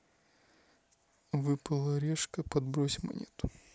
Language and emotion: Russian, neutral